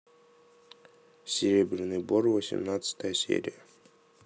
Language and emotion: Russian, neutral